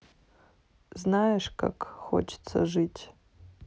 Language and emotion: Russian, sad